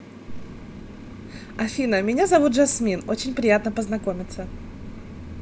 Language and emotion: Russian, positive